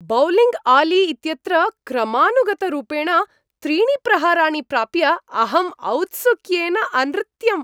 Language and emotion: Sanskrit, happy